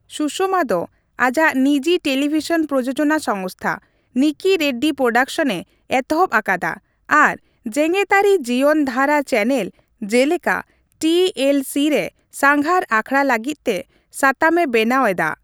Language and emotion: Santali, neutral